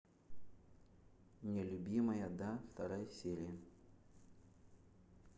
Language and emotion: Russian, neutral